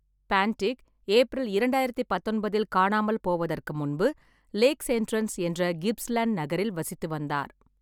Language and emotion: Tamil, neutral